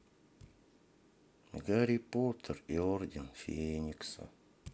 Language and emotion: Russian, sad